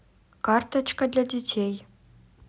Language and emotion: Russian, neutral